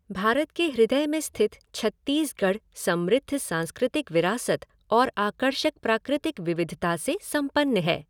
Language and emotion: Hindi, neutral